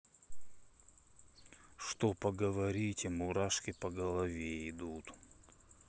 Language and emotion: Russian, neutral